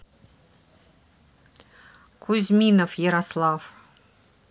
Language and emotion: Russian, neutral